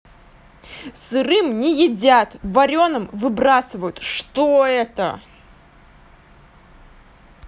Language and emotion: Russian, angry